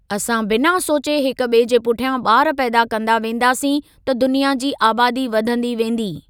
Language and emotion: Sindhi, neutral